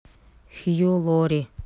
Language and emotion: Russian, neutral